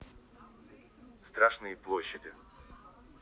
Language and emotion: Russian, neutral